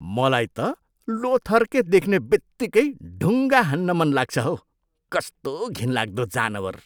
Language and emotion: Nepali, disgusted